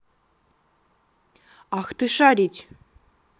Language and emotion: Russian, angry